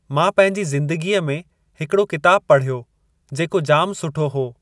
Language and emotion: Sindhi, neutral